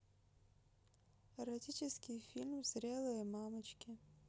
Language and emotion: Russian, neutral